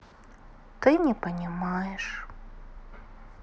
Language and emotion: Russian, sad